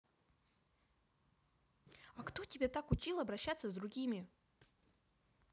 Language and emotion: Russian, angry